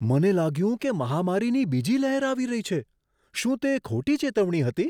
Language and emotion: Gujarati, surprised